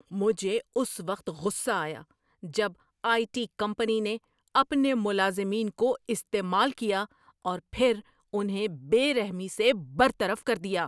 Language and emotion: Urdu, angry